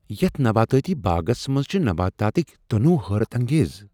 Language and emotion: Kashmiri, surprised